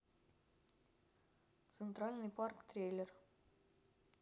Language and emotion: Russian, neutral